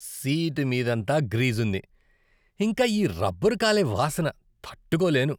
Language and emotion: Telugu, disgusted